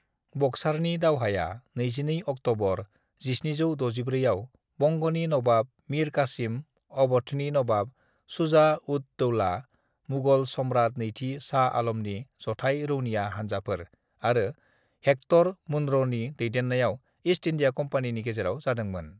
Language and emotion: Bodo, neutral